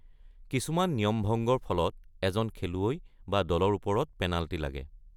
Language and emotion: Assamese, neutral